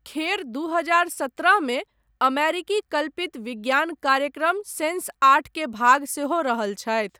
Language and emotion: Maithili, neutral